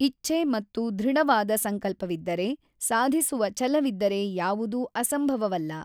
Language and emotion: Kannada, neutral